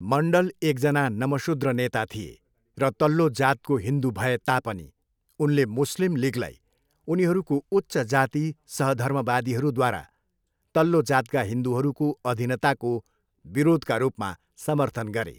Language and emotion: Nepali, neutral